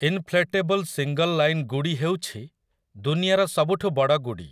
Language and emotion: Odia, neutral